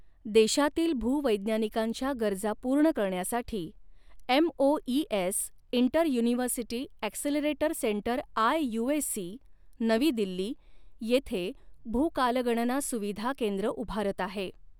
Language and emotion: Marathi, neutral